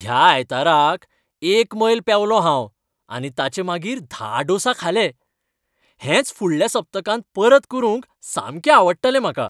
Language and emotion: Goan Konkani, happy